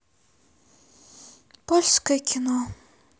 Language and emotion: Russian, sad